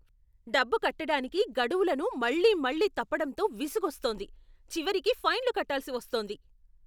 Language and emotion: Telugu, angry